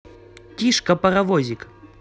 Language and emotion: Russian, positive